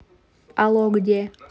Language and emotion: Russian, neutral